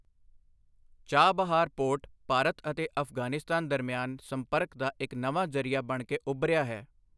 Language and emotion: Punjabi, neutral